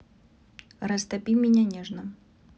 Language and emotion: Russian, neutral